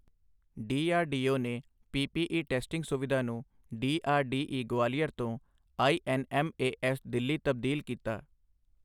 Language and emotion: Punjabi, neutral